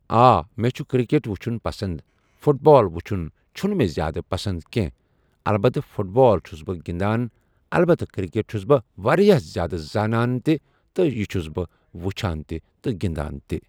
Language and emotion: Kashmiri, neutral